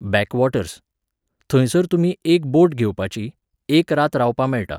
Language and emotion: Goan Konkani, neutral